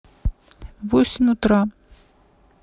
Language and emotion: Russian, neutral